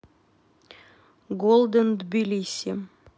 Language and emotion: Russian, neutral